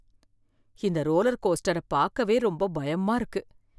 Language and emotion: Tamil, fearful